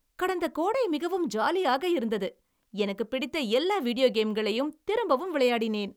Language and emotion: Tamil, happy